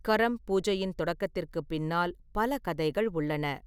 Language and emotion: Tamil, neutral